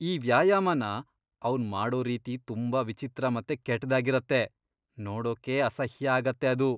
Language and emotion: Kannada, disgusted